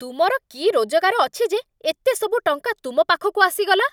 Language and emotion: Odia, angry